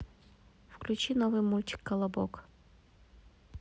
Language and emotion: Russian, neutral